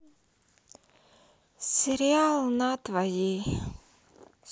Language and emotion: Russian, sad